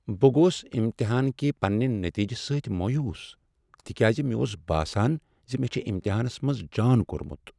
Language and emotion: Kashmiri, sad